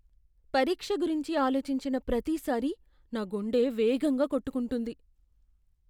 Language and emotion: Telugu, fearful